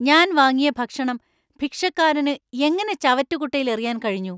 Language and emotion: Malayalam, angry